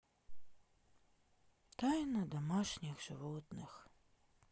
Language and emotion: Russian, sad